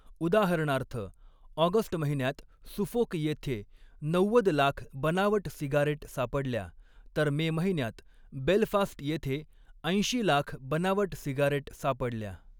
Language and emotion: Marathi, neutral